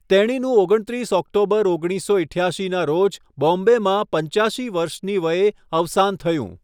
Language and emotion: Gujarati, neutral